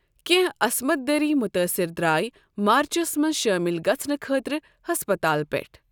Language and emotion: Kashmiri, neutral